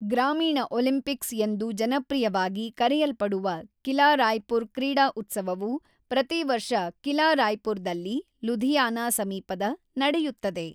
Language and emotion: Kannada, neutral